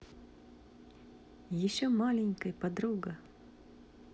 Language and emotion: Russian, positive